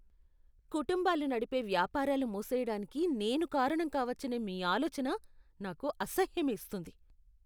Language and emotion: Telugu, disgusted